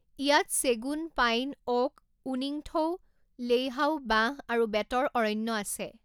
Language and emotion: Assamese, neutral